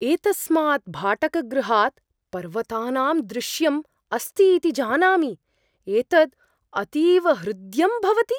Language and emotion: Sanskrit, surprised